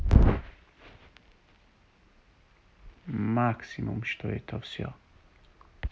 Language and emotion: Russian, neutral